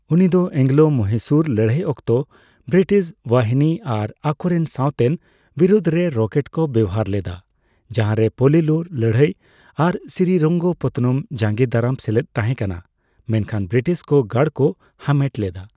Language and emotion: Santali, neutral